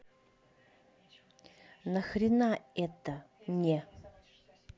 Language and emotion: Russian, angry